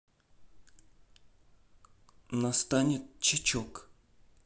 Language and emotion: Russian, neutral